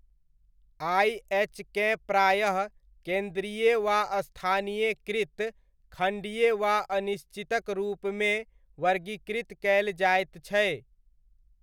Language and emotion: Maithili, neutral